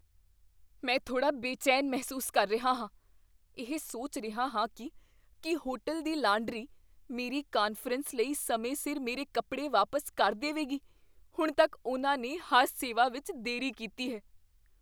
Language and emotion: Punjabi, fearful